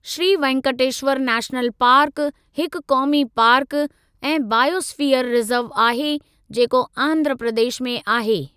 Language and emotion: Sindhi, neutral